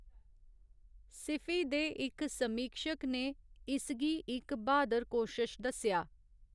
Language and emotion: Dogri, neutral